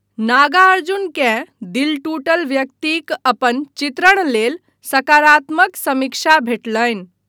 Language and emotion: Maithili, neutral